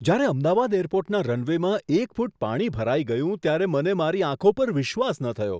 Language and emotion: Gujarati, surprised